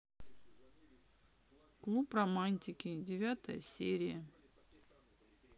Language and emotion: Russian, neutral